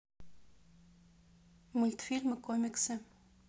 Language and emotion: Russian, neutral